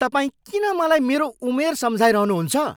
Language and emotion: Nepali, angry